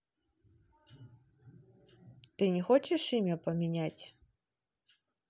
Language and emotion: Russian, neutral